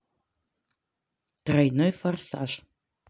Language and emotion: Russian, neutral